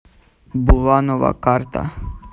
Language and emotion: Russian, neutral